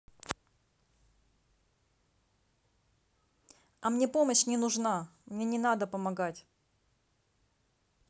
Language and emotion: Russian, neutral